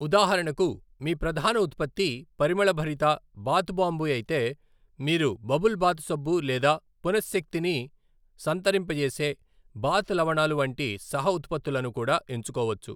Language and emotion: Telugu, neutral